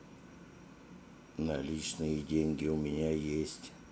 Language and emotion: Russian, neutral